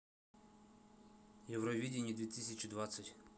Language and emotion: Russian, neutral